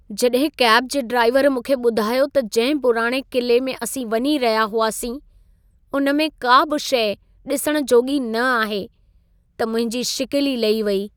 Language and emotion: Sindhi, sad